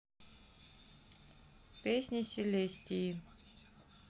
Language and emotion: Russian, neutral